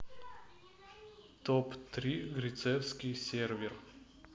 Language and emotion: Russian, neutral